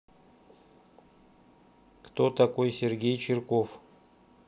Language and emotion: Russian, neutral